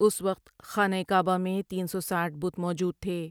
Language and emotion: Urdu, neutral